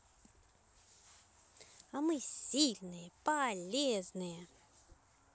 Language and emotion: Russian, positive